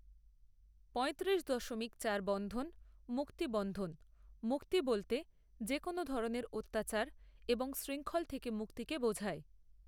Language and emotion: Bengali, neutral